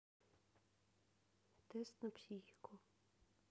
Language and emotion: Russian, neutral